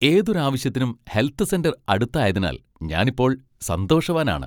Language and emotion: Malayalam, happy